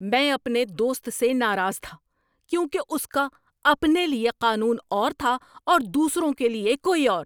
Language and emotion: Urdu, angry